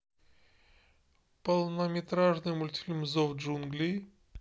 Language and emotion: Russian, neutral